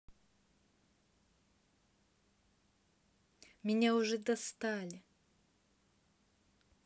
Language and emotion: Russian, angry